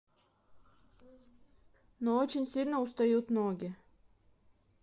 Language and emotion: Russian, neutral